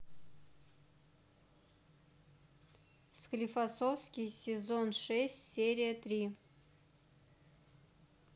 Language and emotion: Russian, neutral